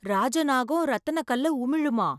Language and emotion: Tamil, surprised